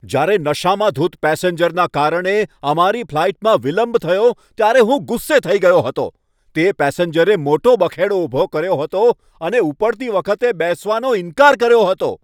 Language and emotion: Gujarati, angry